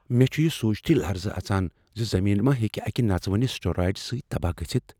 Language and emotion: Kashmiri, fearful